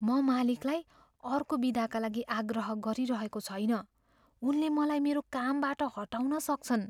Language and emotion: Nepali, fearful